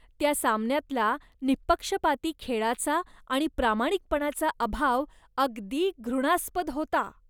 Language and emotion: Marathi, disgusted